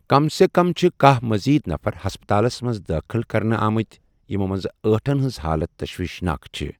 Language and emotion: Kashmiri, neutral